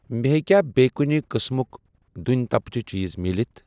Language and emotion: Kashmiri, neutral